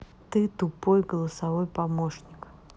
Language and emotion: Russian, neutral